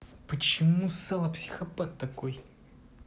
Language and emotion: Russian, angry